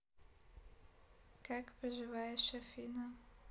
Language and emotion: Russian, neutral